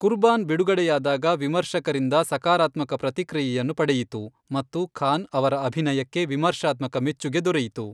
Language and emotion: Kannada, neutral